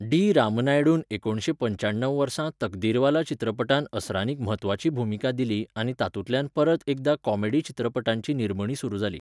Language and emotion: Goan Konkani, neutral